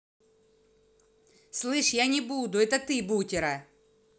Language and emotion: Russian, angry